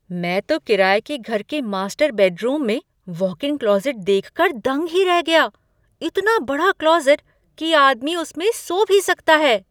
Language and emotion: Hindi, surprised